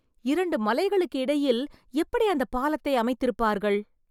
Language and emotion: Tamil, surprised